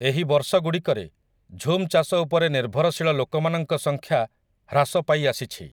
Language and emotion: Odia, neutral